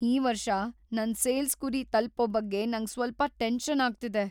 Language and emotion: Kannada, fearful